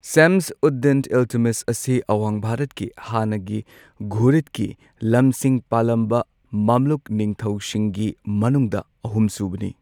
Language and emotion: Manipuri, neutral